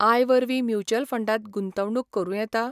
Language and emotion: Goan Konkani, neutral